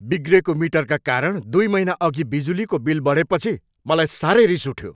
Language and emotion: Nepali, angry